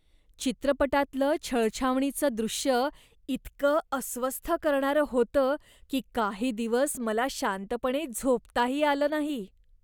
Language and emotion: Marathi, disgusted